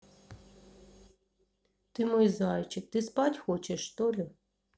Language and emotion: Russian, neutral